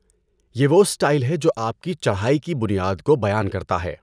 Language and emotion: Urdu, neutral